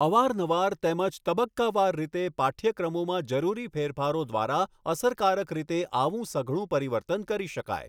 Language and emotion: Gujarati, neutral